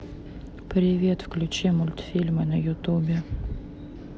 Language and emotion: Russian, neutral